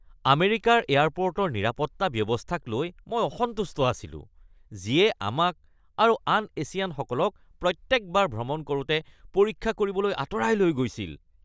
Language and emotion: Assamese, disgusted